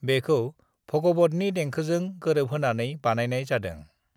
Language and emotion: Bodo, neutral